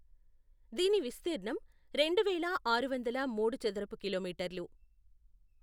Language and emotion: Telugu, neutral